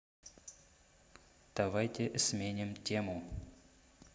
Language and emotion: Russian, neutral